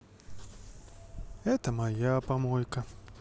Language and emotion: Russian, sad